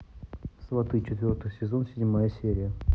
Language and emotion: Russian, neutral